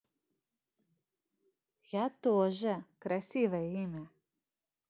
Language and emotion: Russian, positive